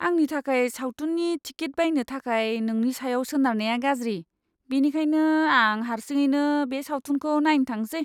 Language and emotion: Bodo, disgusted